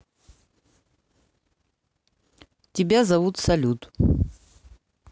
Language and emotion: Russian, neutral